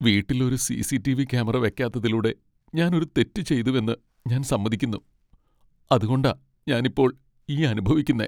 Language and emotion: Malayalam, sad